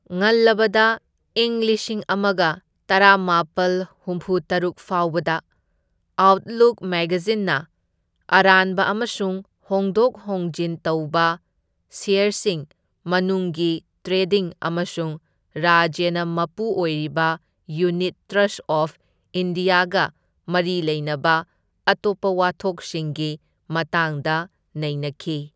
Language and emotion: Manipuri, neutral